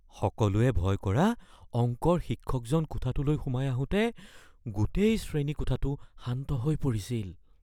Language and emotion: Assamese, fearful